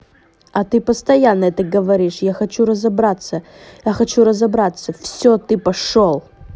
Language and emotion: Russian, angry